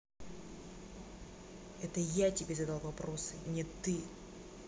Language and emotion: Russian, angry